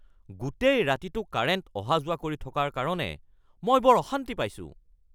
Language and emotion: Assamese, angry